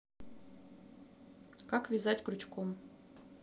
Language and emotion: Russian, neutral